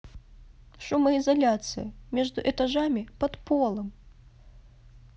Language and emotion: Russian, sad